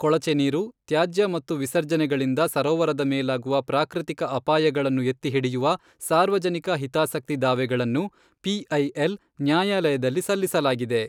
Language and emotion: Kannada, neutral